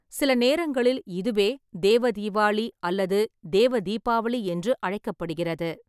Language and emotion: Tamil, neutral